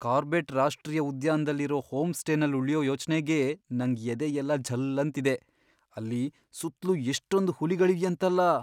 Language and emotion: Kannada, fearful